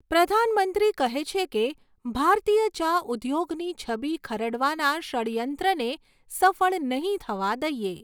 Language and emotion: Gujarati, neutral